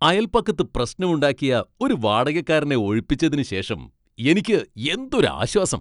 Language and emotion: Malayalam, happy